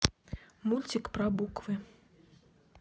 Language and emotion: Russian, neutral